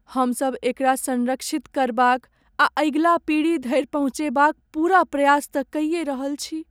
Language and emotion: Maithili, sad